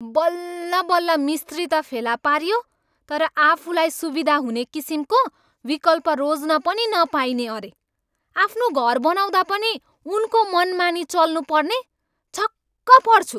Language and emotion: Nepali, angry